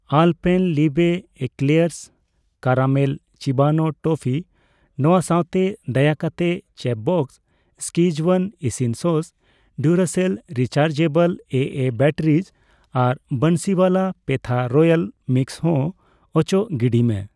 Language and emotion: Santali, neutral